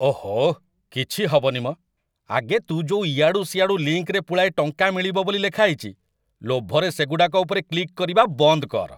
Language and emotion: Odia, disgusted